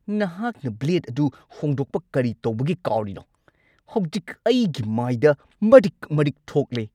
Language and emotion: Manipuri, angry